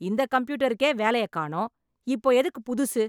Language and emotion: Tamil, angry